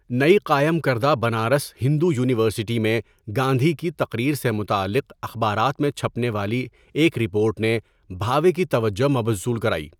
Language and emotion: Urdu, neutral